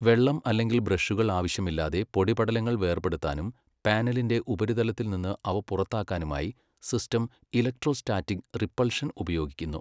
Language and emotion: Malayalam, neutral